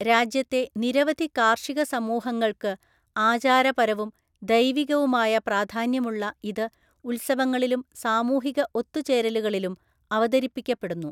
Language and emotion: Malayalam, neutral